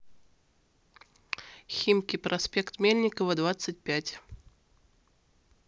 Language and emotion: Russian, neutral